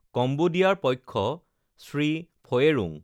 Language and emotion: Assamese, neutral